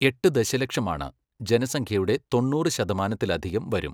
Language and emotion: Malayalam, neutral